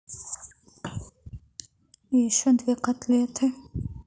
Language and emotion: Russian, sad